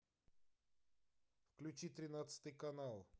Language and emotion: Russian, neutral